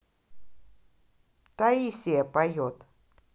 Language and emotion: Russian, angry